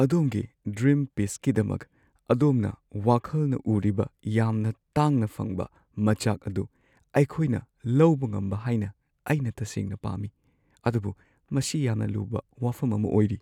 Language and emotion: Manipuri, sad